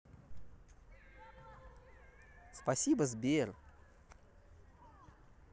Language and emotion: Russian, positive